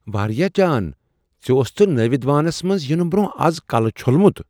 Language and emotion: Kashmiri, surprised